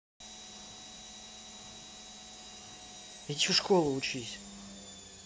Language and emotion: Russian, angry